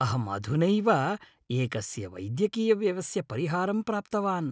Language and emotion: Sanskrit, happy